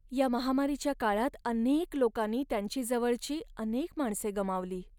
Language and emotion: Marathi, sad